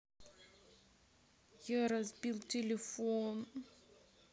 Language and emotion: Russian, sad